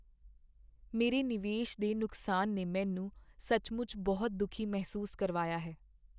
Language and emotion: Punjabi, sad